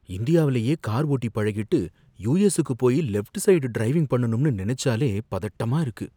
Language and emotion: Tamil, fearful